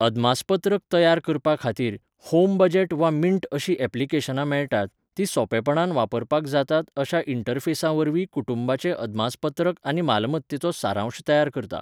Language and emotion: Goan Konkani, neutral